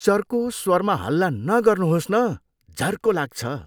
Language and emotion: Nepali, disgusted